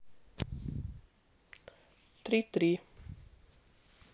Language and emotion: Russian, neutral